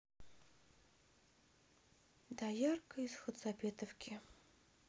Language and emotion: Russian, neutral